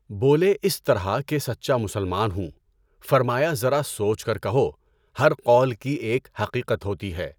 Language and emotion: Urdu, neutral